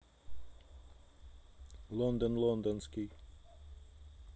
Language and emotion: Russian, neutral